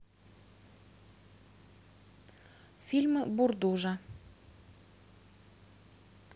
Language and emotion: Russian, neutral